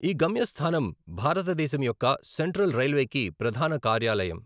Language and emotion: Telugu, neutral